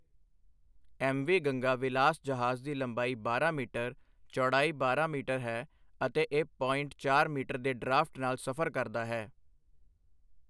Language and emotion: Punjabi, neutral